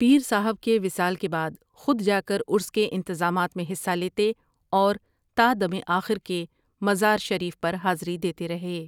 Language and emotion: Urdu, neutral